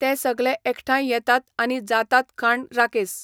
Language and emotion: Goan Konkani, neutral